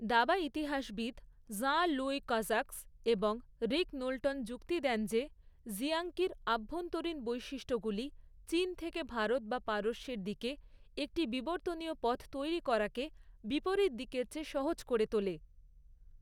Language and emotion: Bengali, neutral